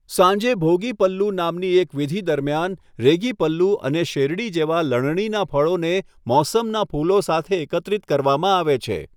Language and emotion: Gujarati, neutral